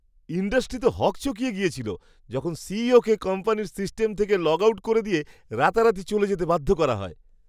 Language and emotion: Bengali, surprised